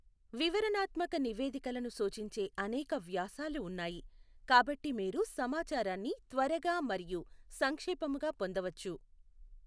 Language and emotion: Telugu, neutral